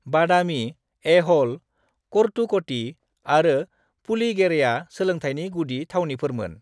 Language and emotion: Bodo, neutral